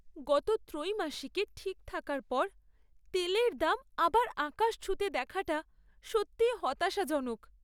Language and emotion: Bengali, sad